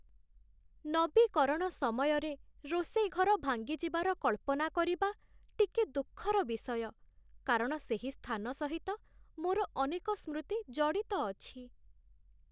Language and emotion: Odia, sad